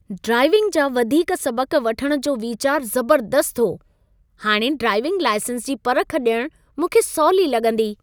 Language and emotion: Sindhi, happy